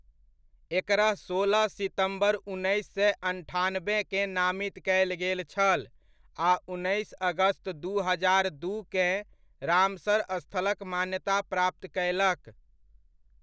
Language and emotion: Maithili, neutral